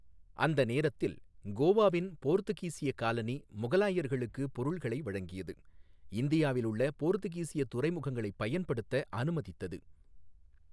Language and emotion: Tamil, neutral